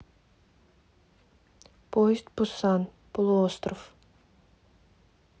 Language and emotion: Russian, neutral